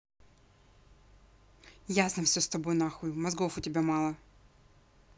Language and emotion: Russian, angry